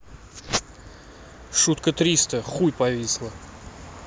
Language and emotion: Russian, angry